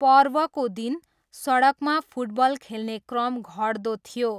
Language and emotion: Nepali, neutral